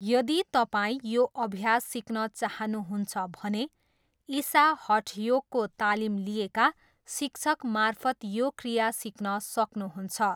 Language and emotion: Nepali, neutral